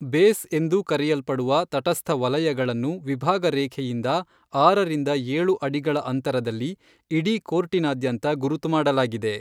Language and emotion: Kannada, neutral